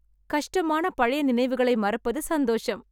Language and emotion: Tamil, happy